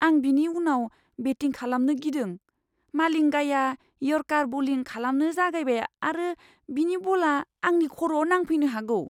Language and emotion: Bodo, fearful